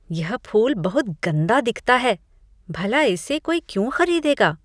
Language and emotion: Hindi, disgusted